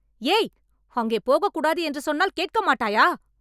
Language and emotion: Tamil, angry